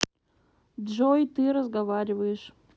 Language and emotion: Russian, neutral